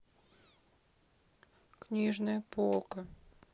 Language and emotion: Russian, sad